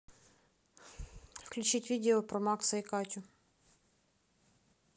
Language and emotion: Russian, neutral